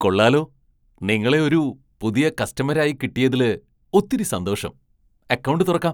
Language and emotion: Malayalam, surprised